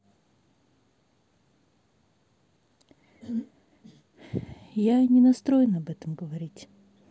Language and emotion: Russian, sad